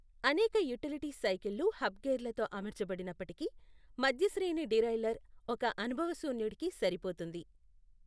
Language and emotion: Telugu, neutral